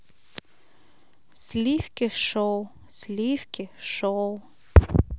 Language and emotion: Russian, neutral